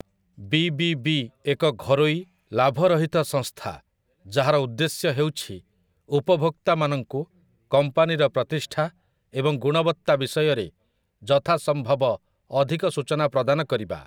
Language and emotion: Odia, neutral